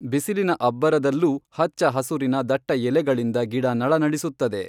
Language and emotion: Kannada, neutral